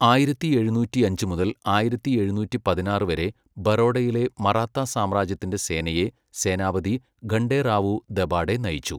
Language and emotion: Malayalam, neutral